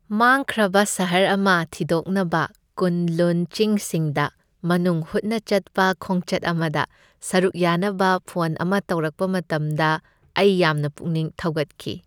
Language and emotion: Manipuri, happy